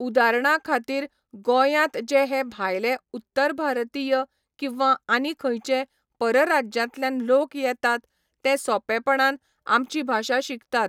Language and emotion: Goan Konkani, neutral